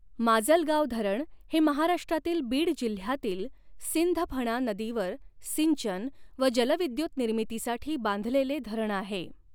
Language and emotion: Marathi, neutral